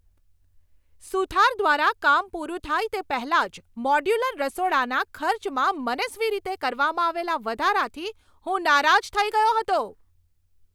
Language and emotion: Gujarati, angry